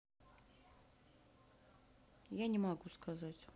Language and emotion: Russian, sad